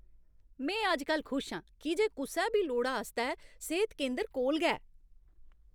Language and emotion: Dogri, happy